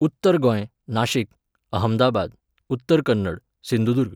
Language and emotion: Goan Konkani, neutral